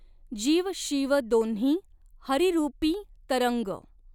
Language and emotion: Marathi, neutral